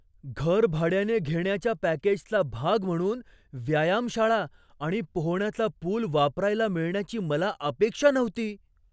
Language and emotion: Marathi, surprised